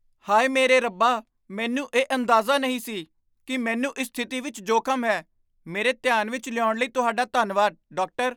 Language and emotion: Punjabi, surprised